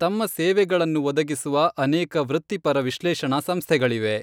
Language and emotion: Kannada, neutral